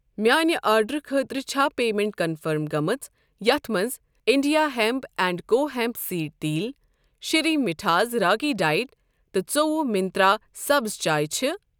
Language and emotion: Kashmiri, neutral